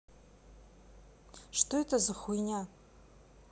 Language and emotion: Russian, neutral